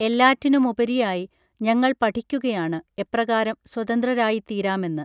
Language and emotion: Malayalam, neutral